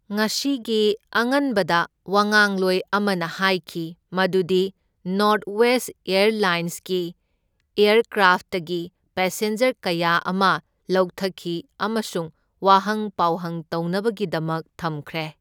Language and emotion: Manipuri, neutral